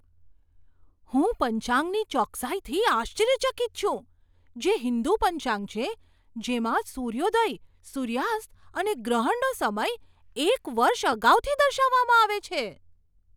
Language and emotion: Gujarati, surprised